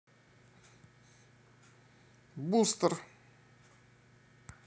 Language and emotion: Russian, neutral